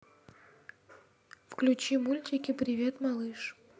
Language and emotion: Russian, neutral